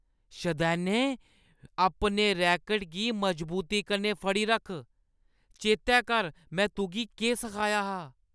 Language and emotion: Dogri, angry